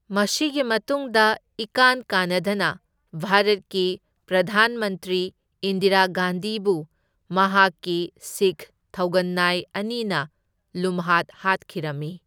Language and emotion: Manipuri, neutral